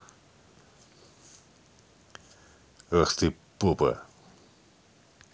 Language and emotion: Russian, angry